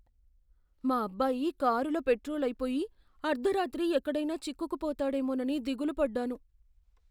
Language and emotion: Telugu, fearful